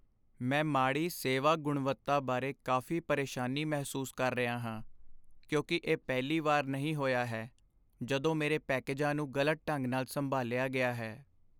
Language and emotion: Punjabi, sad